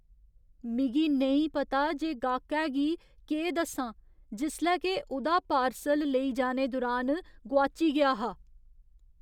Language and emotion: Dogri, fearful